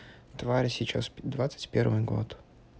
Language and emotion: Russian, neutral